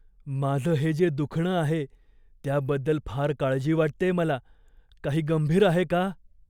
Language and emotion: Marathi, fearful